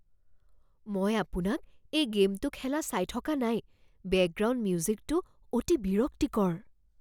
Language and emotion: Assamese, fearful